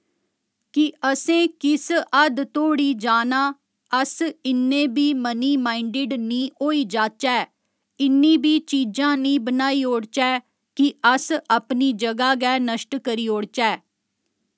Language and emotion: Dogri, neutral